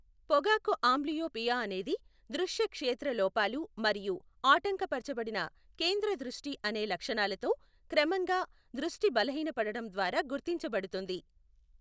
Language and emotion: Telugu, neutral